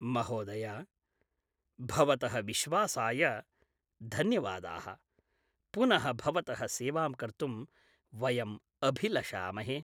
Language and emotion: Sanskrit, happy